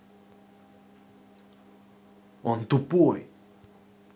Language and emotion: Russian, angry